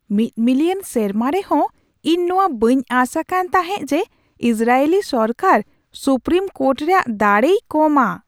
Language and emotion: Santali, surprised